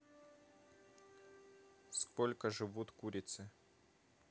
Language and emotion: Russian, neutral